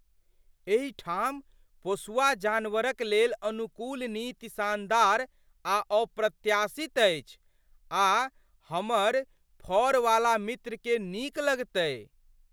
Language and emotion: Maithili, surprised